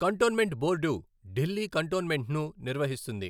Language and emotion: Telugu, neutral